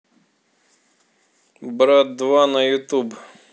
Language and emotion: Russian, neutral